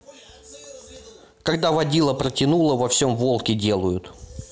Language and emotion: Russian, angry